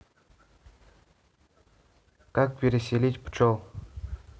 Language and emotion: Russian, neutral